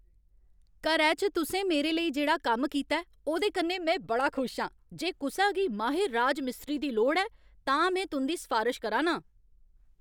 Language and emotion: Dogri, happy